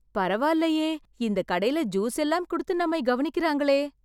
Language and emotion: Tamil, surprised